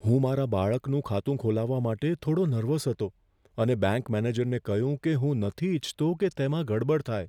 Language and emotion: Gujarati, fearful